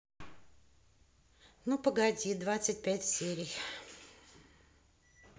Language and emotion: Russian, neutral